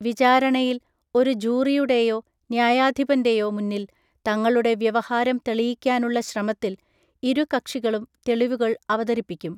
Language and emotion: Malayalam, neutral